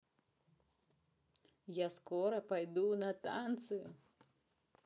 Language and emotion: Russian, positive